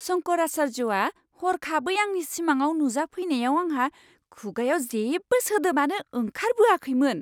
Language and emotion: Bodo, surprised